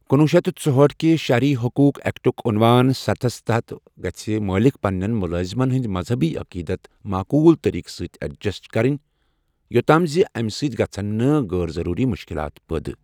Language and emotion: Kashmiri, neutral